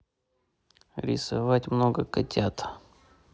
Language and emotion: Russian, neutral